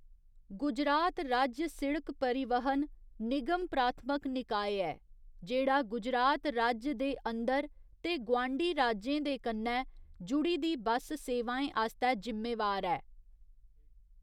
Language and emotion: Dogri, neutral